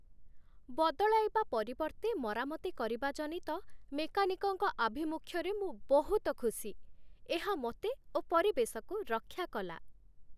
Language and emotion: Odia, happy